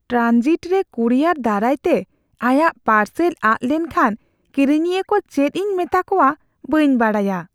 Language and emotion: Santali, fearful